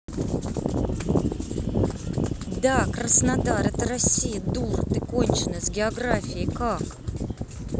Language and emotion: Russian, angry